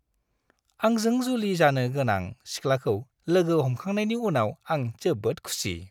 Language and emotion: Bodo, happy